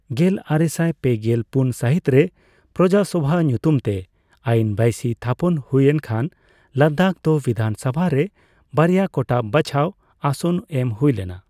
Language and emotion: Santali, neutral